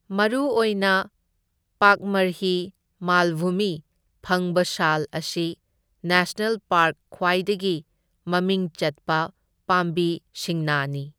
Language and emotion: Manipuri, neutral